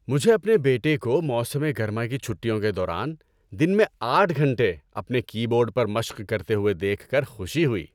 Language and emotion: Urdu, happy